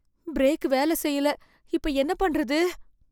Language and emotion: Tamil, fearful